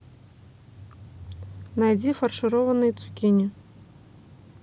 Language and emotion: Russian, neutral